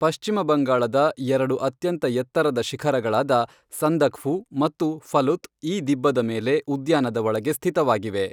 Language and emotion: Kannada, neutral